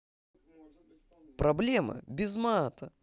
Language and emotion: Russian, positive